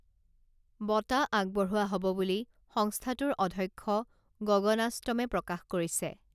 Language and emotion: Assamese, neutral